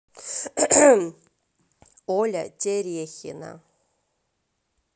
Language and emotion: Russian, neutral